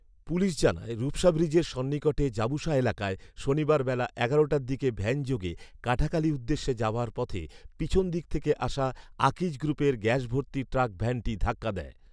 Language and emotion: Bengali, neutral